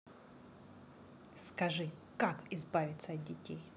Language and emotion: Russian, angry